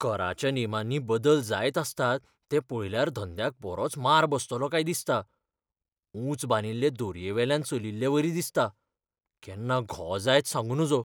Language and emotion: Goan Konkani, fearful